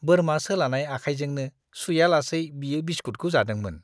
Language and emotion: Bodo, disgusted